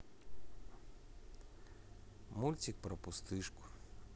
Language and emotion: Russian, neutral